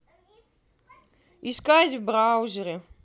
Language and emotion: Russian, neutral